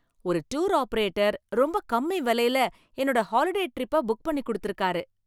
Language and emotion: Tamil, happy